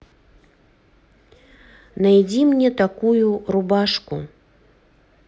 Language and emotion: Russian, neutral